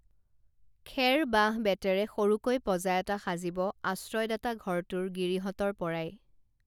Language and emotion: Assamese, neutral